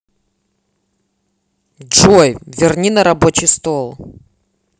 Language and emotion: Russian, angry